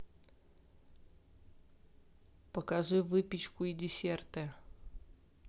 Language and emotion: Russian, neutral